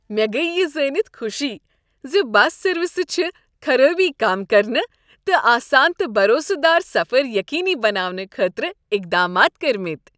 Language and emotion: Kashmiri, happy